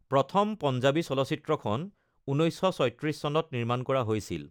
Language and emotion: Assamese, neutral